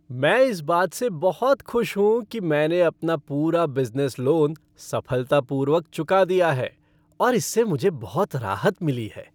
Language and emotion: Hindi, happy